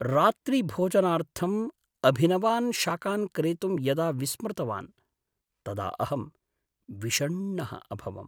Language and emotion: Sanskrit, sad